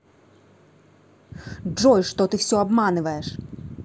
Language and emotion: Russian, angry